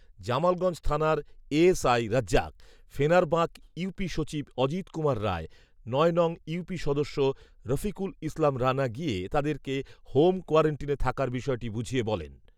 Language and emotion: Bengali, neutral